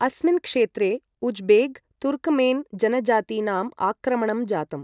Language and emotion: Sanskrit, neutral